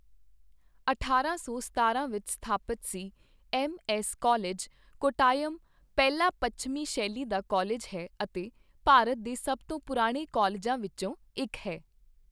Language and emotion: Punjabi, neutral